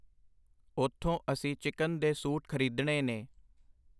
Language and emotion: Punjabi, neutral